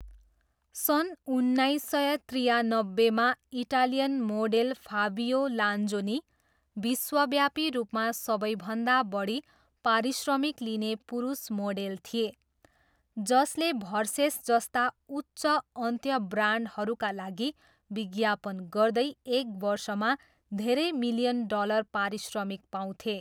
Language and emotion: Nepali, neutral